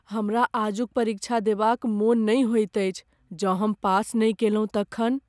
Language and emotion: Maithili, fearful